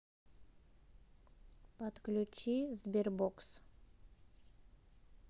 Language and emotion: Russian, neutral